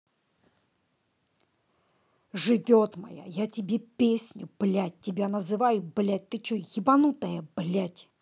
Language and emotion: Russian, angry